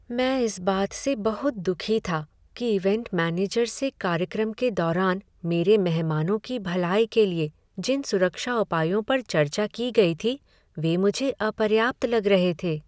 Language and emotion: Hindi, sad